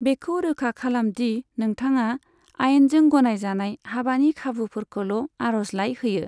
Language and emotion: Bodo, neutral